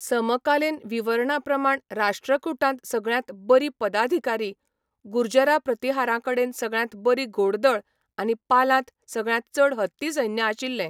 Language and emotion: Goan Konkani, neutral